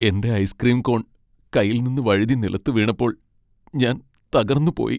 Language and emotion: Malayalam, sad